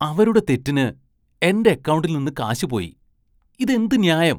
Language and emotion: Malayalam, disgusted